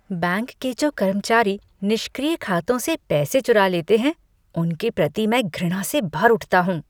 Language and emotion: Hindi, disgusted